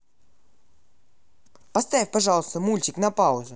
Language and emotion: Russian, neutral